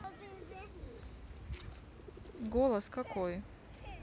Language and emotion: Russian, neutral